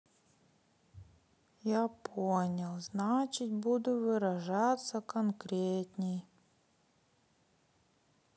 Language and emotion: Russian, sad